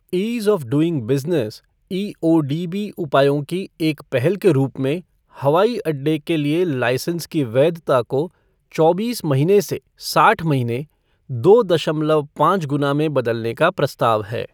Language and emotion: Hindi, neutral